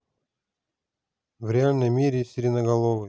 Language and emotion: Russian, neutral